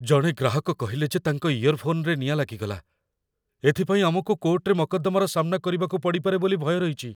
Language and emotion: Odia, fearful